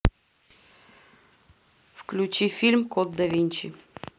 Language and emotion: Russian, neutral